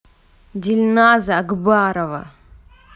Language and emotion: Russian, angry